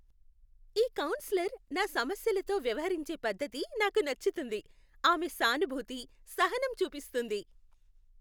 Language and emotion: Telugu, happy